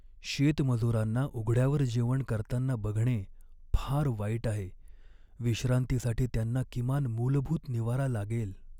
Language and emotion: Marathi, sad